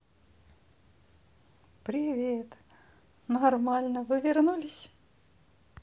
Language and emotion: Russian, positive